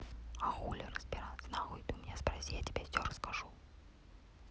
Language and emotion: Russian, neutral